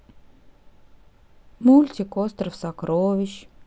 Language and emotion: Russian, sad